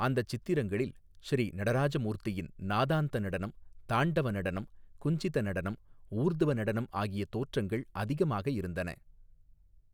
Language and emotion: Tamil, neutral